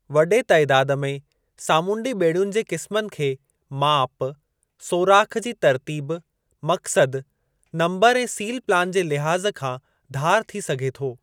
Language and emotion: Sindhi, neutral